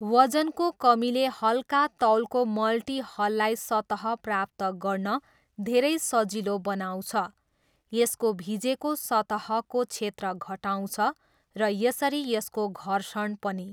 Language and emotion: Nepali, neutral